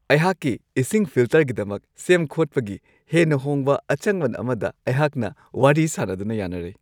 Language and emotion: Manipuri, happy